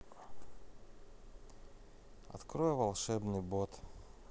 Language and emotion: Russian, neutral